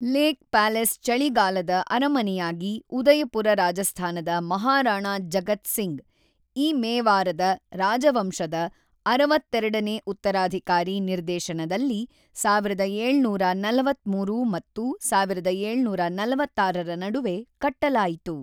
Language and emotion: Kannada, neutral